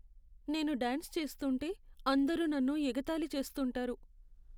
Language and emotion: Telugu, sad